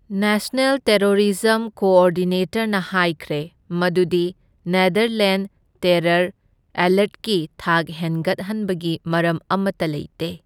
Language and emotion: Manipuri, neutral